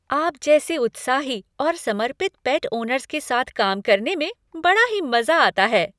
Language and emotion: Hindi, happy